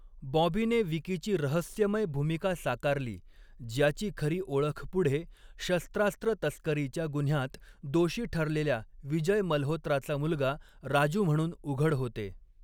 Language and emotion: Marathi, neutral